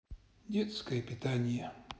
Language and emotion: Russian, sad